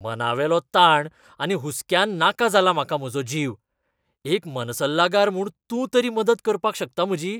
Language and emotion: Goan Konkani, disgusted